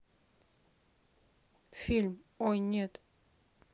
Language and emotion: Russian, neutral